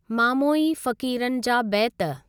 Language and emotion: Sindhi, neutral